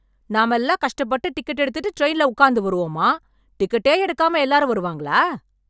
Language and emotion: Tamil, angry